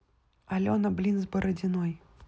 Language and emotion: Russian, neutral